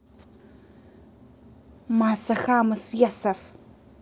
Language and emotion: Russian, angry